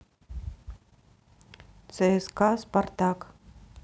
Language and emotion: Russian, neutral